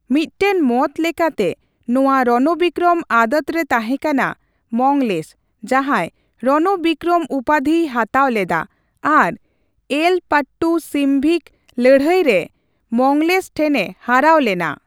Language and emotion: Santali, neutral